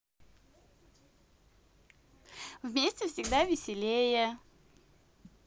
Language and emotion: Russian, positive